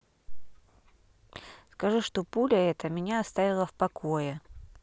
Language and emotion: Russian, neutral